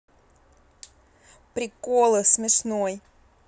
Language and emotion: Russian, neutral